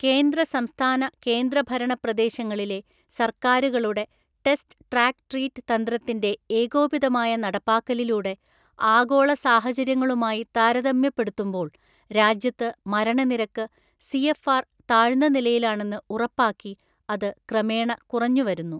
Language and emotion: Malayalam, neutral